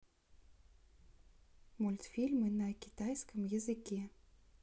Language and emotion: Russian, neutral